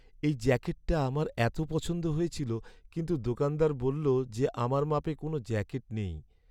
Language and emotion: Bengali, sad